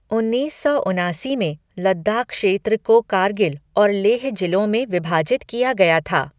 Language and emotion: Hindi, neutral